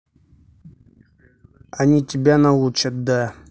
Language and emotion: Russian, neutral